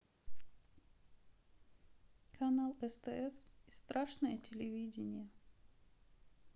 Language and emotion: Russian, sad